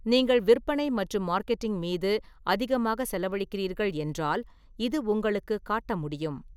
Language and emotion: Tamil, neutral